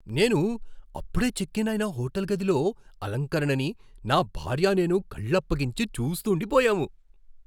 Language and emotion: Telugu, surprised